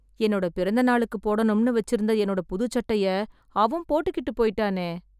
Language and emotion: Tamil, sad